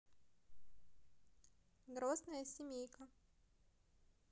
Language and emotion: Russian, neutral